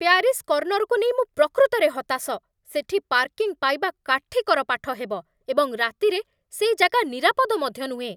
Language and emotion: Odia, angry